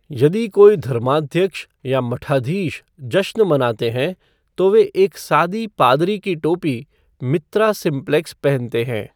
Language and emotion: Hindi, neutral